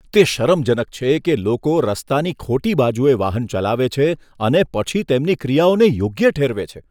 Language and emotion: Gujarati, disgusted